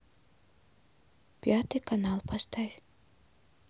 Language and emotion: Russian, neutral